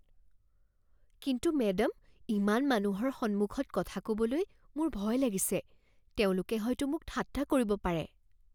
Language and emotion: Assamese, fearful